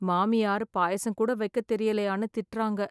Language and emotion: Tamil, sad